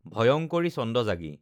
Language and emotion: Assamese, neutral